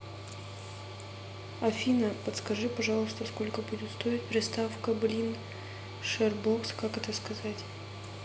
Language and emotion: Russian, neutral